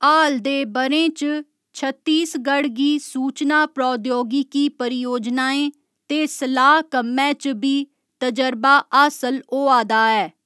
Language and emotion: Dogri, neutral